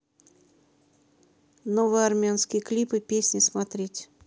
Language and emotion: Russian, neutral